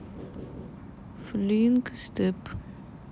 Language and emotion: Russian, neutral